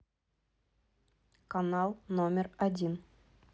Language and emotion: Russian, neutral